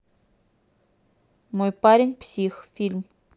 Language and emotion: Russian, neutral